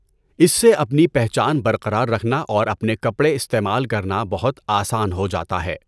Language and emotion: Urdu, neutral